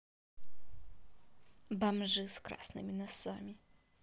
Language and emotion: Russian, neutral